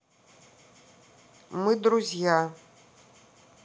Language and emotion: Russian, neutral